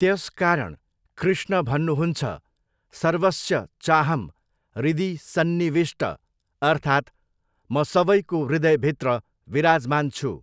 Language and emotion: Nepali, neutral